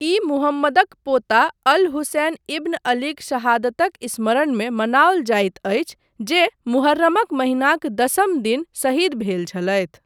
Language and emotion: Maithili, neutral